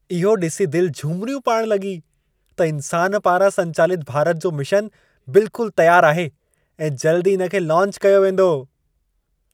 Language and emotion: Sindhi, happy